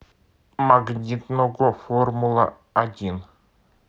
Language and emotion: Russian, neutral